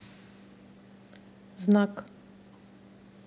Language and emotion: Russian, neutral